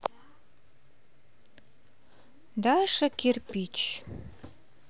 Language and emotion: Russian, neutral